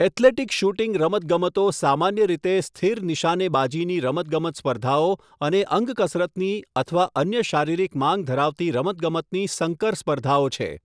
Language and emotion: Gujarati, neutral